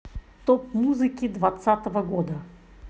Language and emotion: Russian, neutral